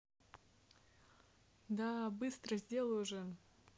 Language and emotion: Russian, neutral